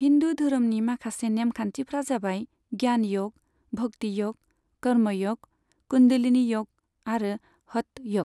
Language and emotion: Bodo, neutral